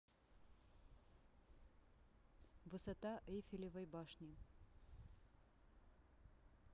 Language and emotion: Russian, neutral